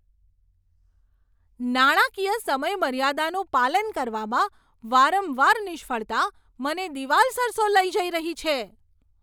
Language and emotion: Gujarati, angry